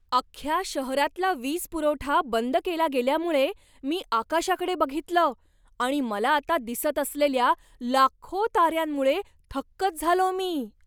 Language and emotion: Marathi, surprised